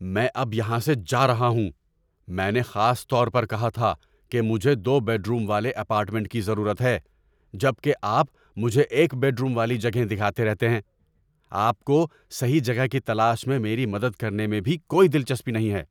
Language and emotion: Urdu, angry